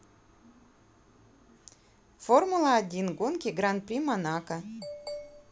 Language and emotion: Russian, neutral